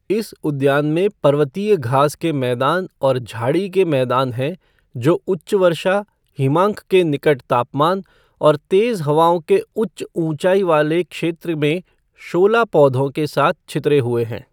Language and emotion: Hindi, neutral